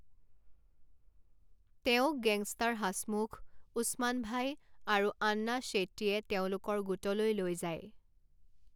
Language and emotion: Assamese, neutral